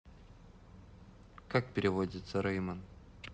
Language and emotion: Russian, neutral